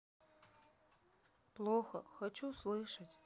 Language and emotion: Russian, sad